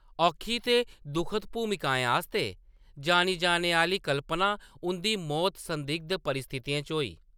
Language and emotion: Dogri, neutral